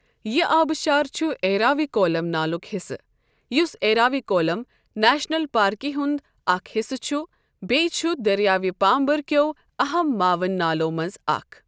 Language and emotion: Kashmiri, neutral